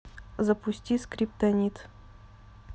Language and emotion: Russian, neutral